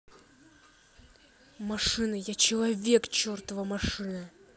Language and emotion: Russian, angry